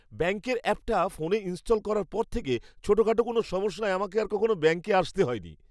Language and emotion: Bengali, happy